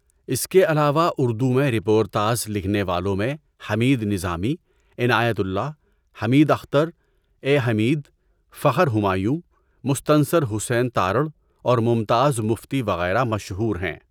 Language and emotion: Urdu, neutral